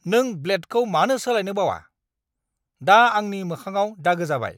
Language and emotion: Bodo, angry